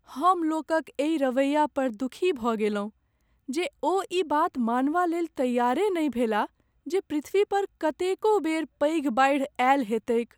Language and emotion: Maithili, sad